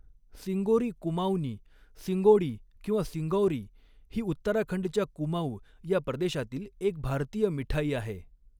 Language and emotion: Marathi, neutral